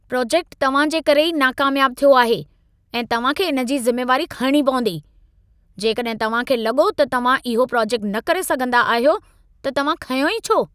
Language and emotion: Sindhi, angry